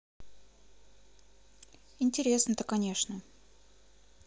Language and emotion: Russian, neutral